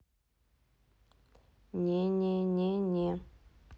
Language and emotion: Russian, neutral